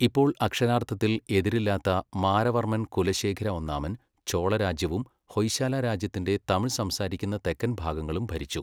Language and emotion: Malayalam, neutral